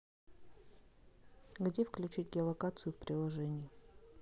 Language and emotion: Russian, neutral